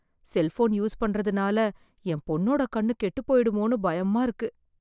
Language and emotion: Tamil, fearful